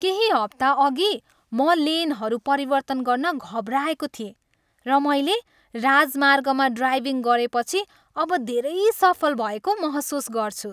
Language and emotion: Nepali, happy